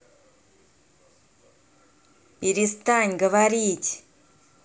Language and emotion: Russian, angry